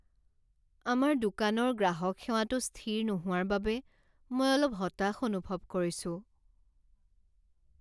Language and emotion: Assamese, sad